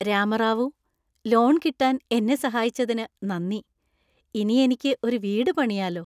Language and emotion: Malayalam, happy